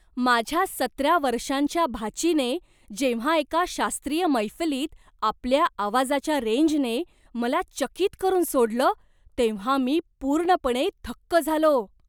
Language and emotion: Marathi, surprised